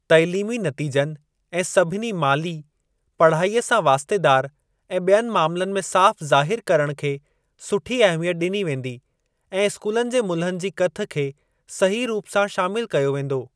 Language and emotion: Sindhi, neutral